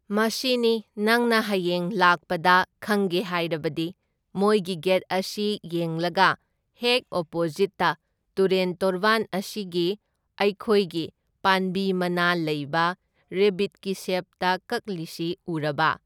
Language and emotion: Manipuri, neutral